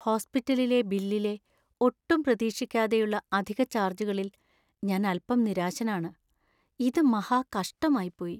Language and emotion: Malayalam, sad